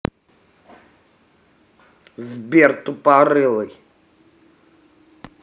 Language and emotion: Russian, angry